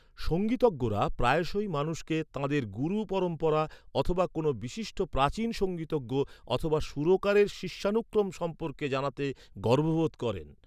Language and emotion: Bengali, neutral